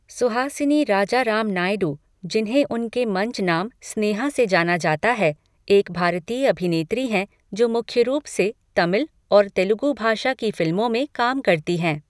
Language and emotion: Hindi, neutral